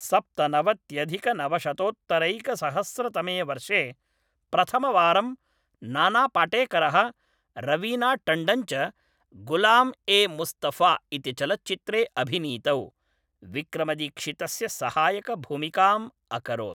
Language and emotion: Sanskrit, neutral